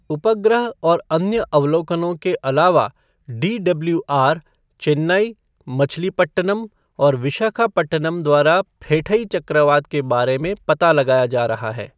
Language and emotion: Hindi, neutral